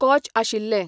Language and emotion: Goan Konkani, neutral